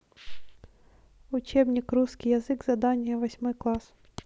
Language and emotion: Russian, neutral